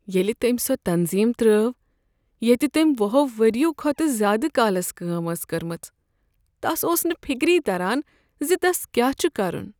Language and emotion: Kashmiri, sad